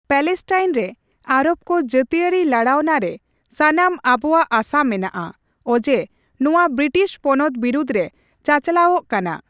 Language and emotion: Santali, neutral